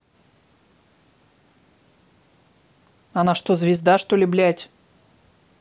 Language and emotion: Russian, angry